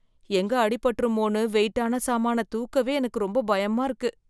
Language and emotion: Tamil, fearful